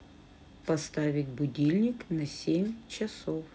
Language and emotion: Russian, neutral